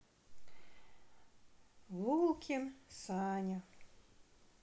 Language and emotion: Russian, sad